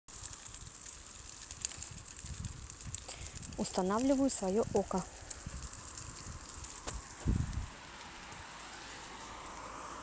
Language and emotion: Russian, neutral